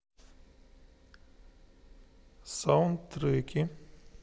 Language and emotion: Russian, neutral